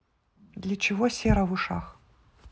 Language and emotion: Russian, neutral